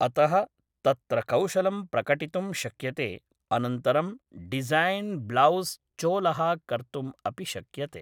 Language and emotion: Sanskrit, neutral